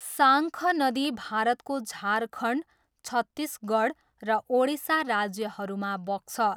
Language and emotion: Nepali, neutral